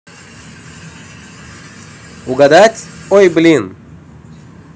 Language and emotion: Russian, positive